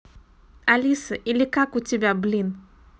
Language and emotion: Russian, neutral